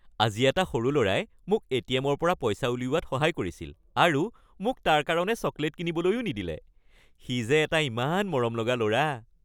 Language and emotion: Assamese, happy